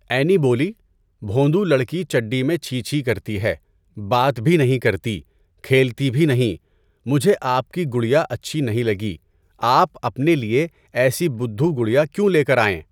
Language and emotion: Urdu, neutral